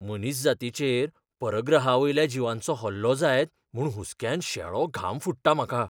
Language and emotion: Goan Konkani, fearful